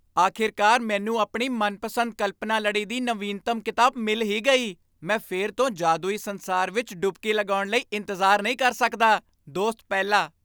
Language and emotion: Punjabi, happy